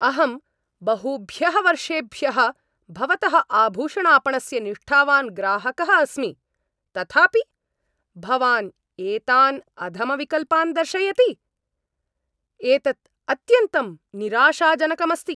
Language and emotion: Sanskrit, angry